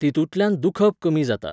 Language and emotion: Goan Konkani, neutral